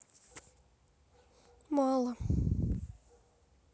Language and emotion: Russian, sad